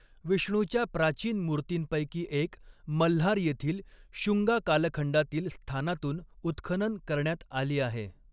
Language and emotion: Marathi, neutral